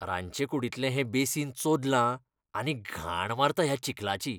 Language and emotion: Goan Konkani, disgusted